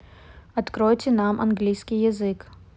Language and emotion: Russian, neutral